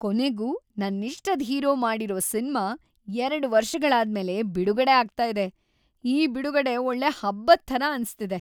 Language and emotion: Kannada, happy